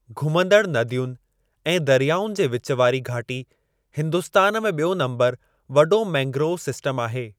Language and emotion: Sindhi, neutral